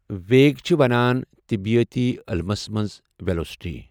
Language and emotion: Kashmiri, neutral